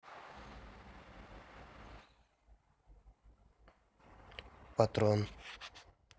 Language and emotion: Russian, neutral